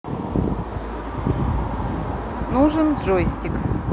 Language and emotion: Russian, neutral